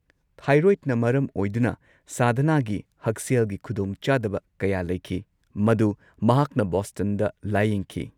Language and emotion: Manipuri, neutral